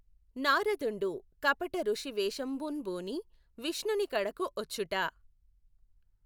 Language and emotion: Telugu, neutral